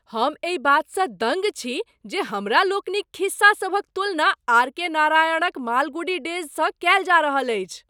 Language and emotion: Maithili, surprised